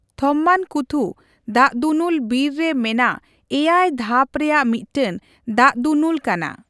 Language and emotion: Santali, neutral